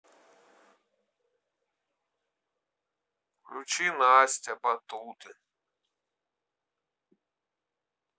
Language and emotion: Russian, sad